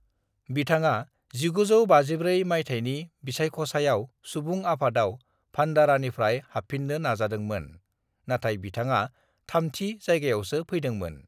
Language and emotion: Bodo, neutral